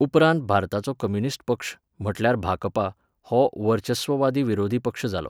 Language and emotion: Goan Konkani, neutral